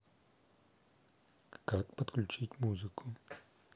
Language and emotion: Russian, neutral